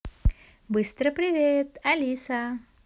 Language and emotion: Russian, positive